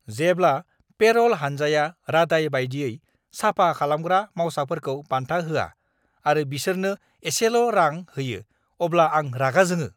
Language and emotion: Bodo, angry